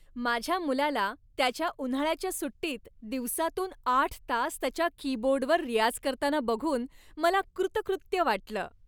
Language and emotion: Marathi, happy